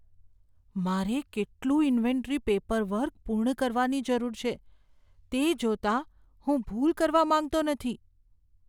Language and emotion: Gujarati, fearful